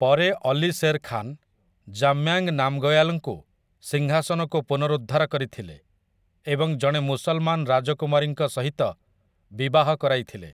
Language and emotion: Odia, neutral